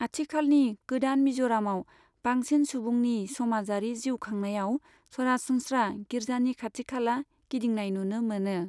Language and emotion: Bodo, neutral